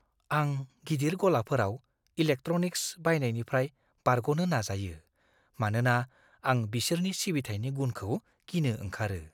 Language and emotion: Bodo, fearful